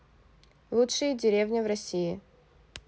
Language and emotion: Russian, neutral